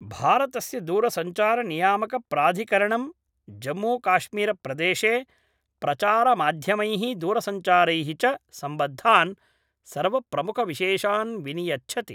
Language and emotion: Sanskrit, neutral